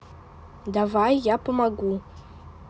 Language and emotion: Russian, neutral